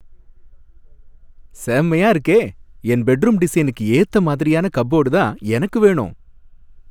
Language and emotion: Tamil, happy